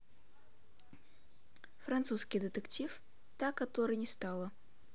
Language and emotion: Russian, neutral